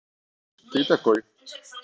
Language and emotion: Russian, neutral